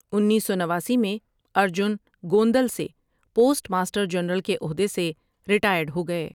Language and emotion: Urdu, neutral